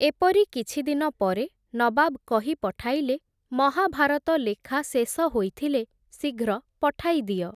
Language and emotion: Odia, neutral